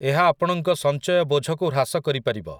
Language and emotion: Odia, neutral